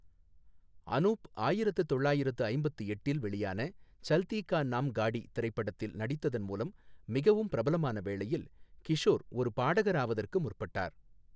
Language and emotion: Tamil, neutral